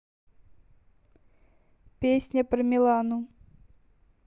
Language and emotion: Russian, neutral